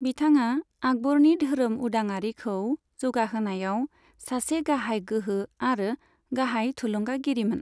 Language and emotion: Bodo, neutral